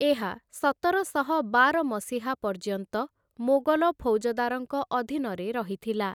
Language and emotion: Odia, neutral